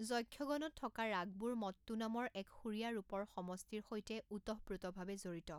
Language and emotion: Assamese, neutral